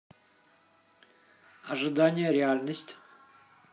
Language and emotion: Russian, neutral